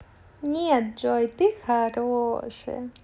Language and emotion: Russian, positive